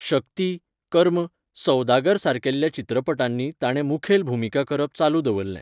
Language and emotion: Goan Konkani, neutral